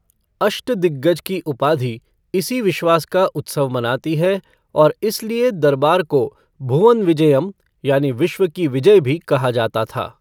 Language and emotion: Hindi, neutral